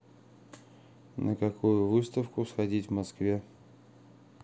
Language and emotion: Russian, neutral